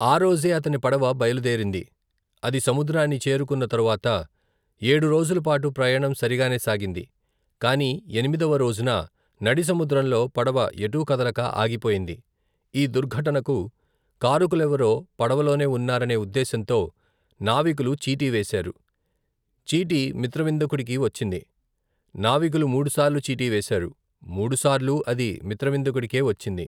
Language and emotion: Telugu, neutral